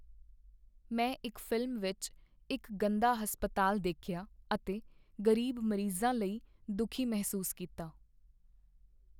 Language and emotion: Punjabi, sad